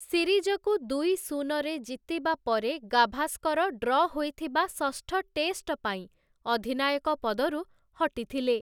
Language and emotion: Odia, neutral